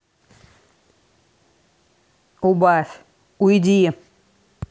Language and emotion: Russian, angry